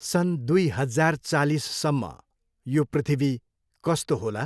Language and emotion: Nepali, neutral